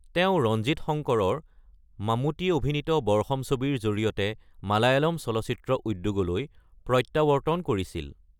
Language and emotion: Assamese, neutral